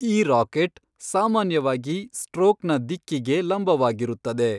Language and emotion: Kannada, neutral